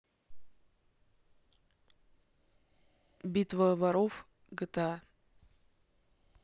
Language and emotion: Russian, neutral